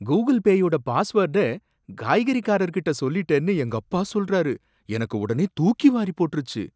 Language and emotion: Tamil, surprised